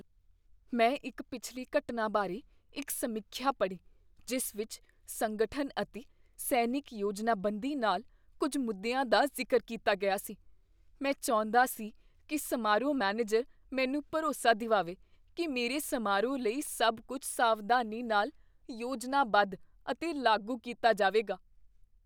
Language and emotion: Punjabi, fearful